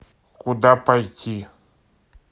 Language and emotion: Russian, neutral